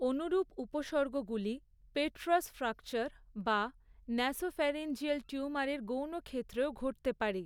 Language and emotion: Bengali, neutral